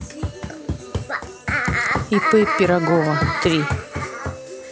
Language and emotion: Russian, neutral